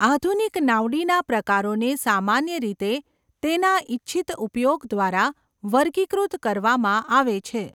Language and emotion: Gujarati, neutral